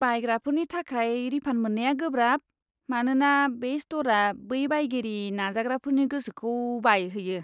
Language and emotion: Bodo, disgusted